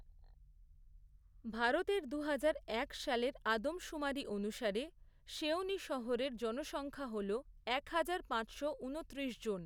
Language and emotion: Bengali, neutral